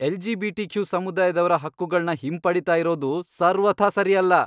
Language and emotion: Kannada, angry